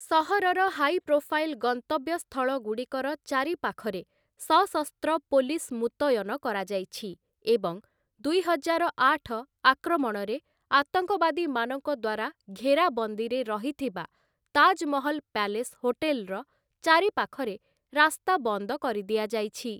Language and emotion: Odia, neutral